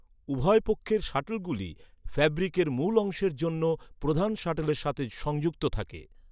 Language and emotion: Bengali, neutral